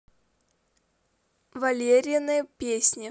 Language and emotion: Russian, neutral